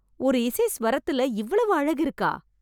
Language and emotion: Tamil, surprised